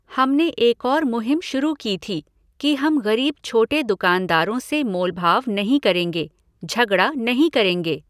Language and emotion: Hindi, neutral